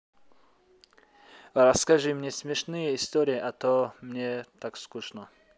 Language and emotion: Russian, neutral